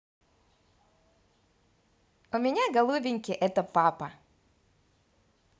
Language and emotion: Russian, positive